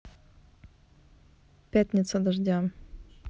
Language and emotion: Russian, neutral